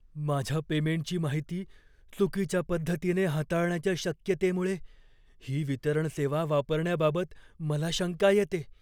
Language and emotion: Marathi, fearful